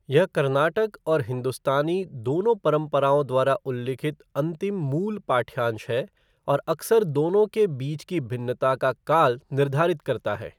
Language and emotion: Hindi, neutral